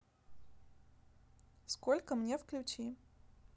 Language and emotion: Russian, neutral